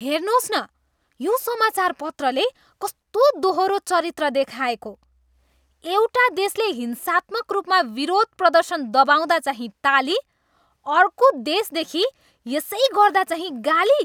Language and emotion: Nepali, disgusted